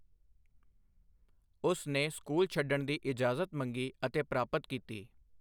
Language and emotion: Punjabi, neutral